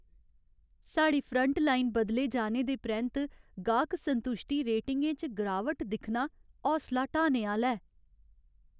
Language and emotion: Dogri, sad